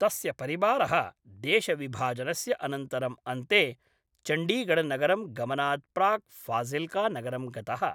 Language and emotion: Sanskrit, neutral